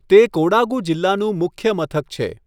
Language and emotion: Gujarati, neutral